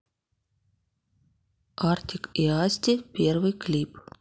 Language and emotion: Russian, neutral